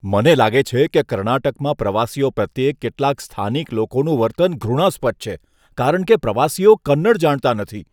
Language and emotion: Gujarati, disgusted